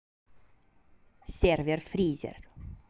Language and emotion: Russian, neutral